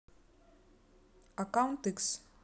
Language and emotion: Russian, neutral